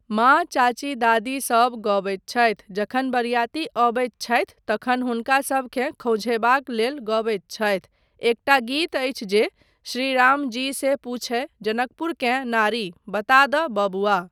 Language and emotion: Maithili, neutral